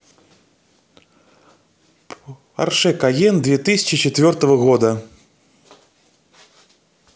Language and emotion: Russian, neutral